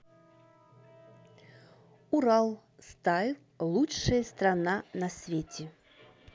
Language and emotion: Russian, neutral